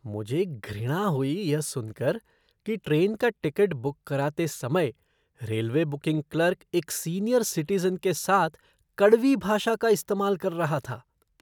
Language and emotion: Hindi, disgusted